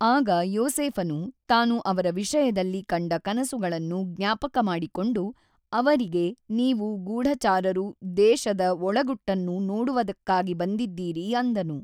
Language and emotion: Kannada, neutral